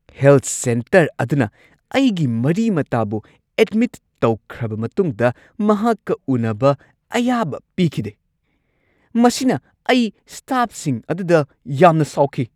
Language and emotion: Manipuri, angry